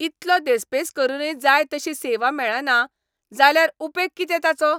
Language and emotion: Goan Konkani, angry